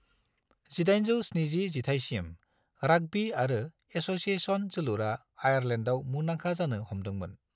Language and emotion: Bodo, neutral